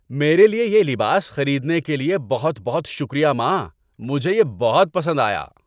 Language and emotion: Urdu, happy